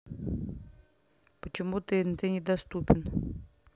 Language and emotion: Russian, neutral